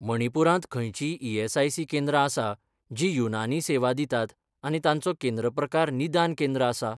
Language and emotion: Goan Konkani, neutral